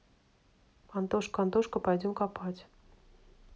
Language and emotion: Russian, neutral